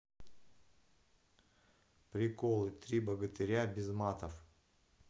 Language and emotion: Russian, neutral